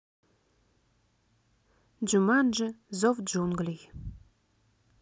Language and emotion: Russian, neutral